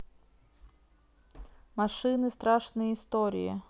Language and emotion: Russian, neutral